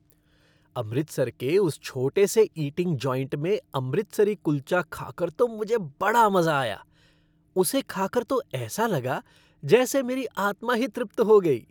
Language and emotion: Hindi, happy